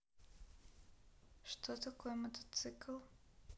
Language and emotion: Russian, sad